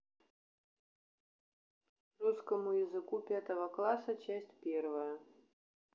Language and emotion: Russian, neutral